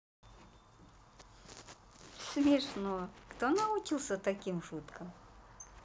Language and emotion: Russian, positive